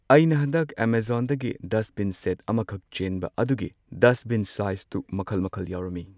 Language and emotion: Manipuri, neutral